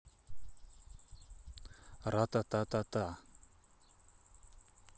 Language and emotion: Russian, neutral